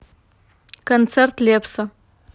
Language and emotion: Russian, neutral